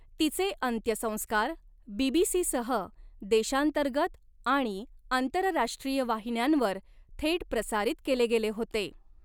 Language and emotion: Marathi, neutral